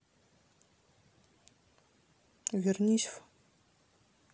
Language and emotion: Russian, neutral